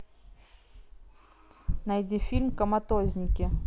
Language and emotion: Russian, neutral